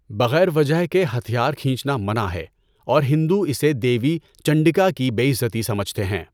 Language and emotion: Urdu, neutral